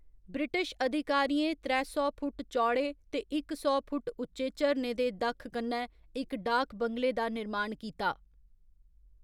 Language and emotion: Dogri, neutral